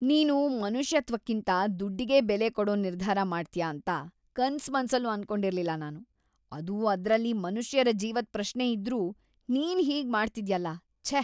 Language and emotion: Kannada, disgusted